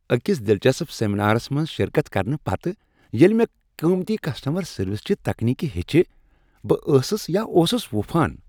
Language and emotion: Kashmiri, happy